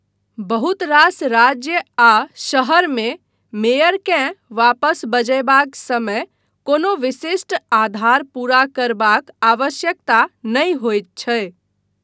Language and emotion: Maithili, neutral